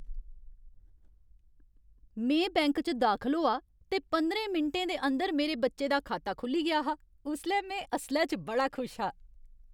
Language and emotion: Dogri, happy